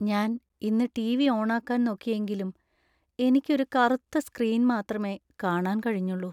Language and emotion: Malayalam, sad